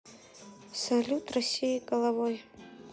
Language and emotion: Russian, sad